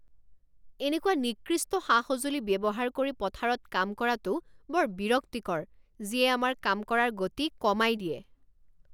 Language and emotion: Assamese, angry